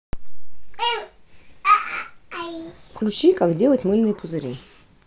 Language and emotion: Russian, neutral